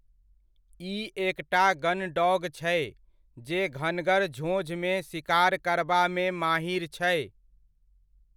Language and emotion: Maithili, neutral